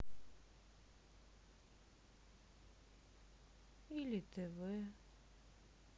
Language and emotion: Russian, sad